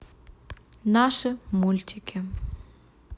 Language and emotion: Russian, neutral